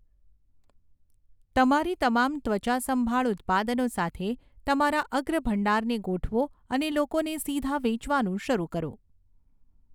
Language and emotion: Gujarati, neutral